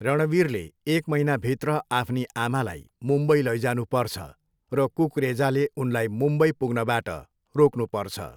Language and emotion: Nepali, neutral